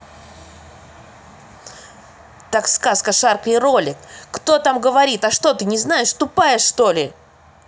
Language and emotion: Russian, angry